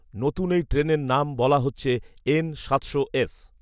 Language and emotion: Bengali, neutral